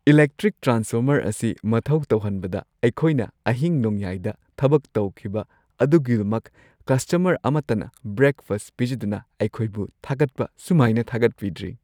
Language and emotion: Manipuri, happy